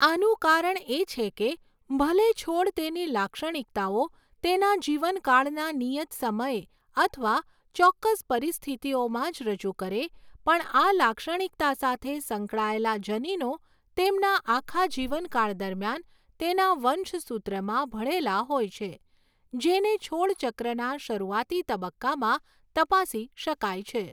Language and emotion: Gujarati, neutral